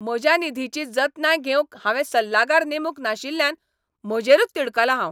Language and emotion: Goan Konkani, angry